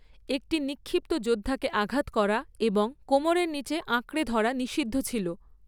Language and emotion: Bengali, neutral